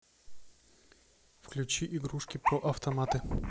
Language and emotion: Russian, neutral